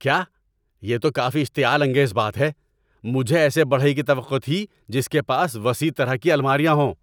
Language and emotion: Urdu, angry